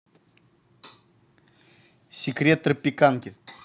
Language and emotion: Russian, neutral